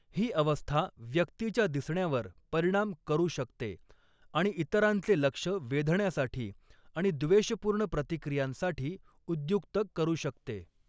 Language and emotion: Marathi, neutral